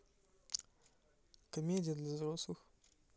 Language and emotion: Russian, neutral